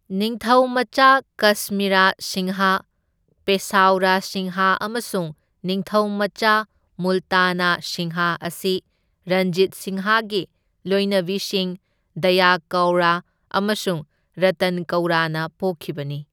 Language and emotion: Manipuri, neutral